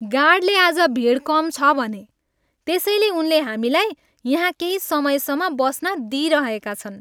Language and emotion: Nepali, happy